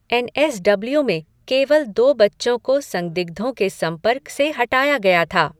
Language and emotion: Hindi, neutral